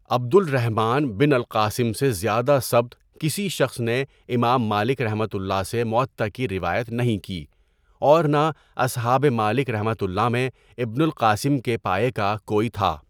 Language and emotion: Urdu, neutral